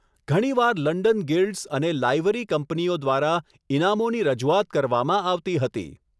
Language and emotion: Gujarati, neutral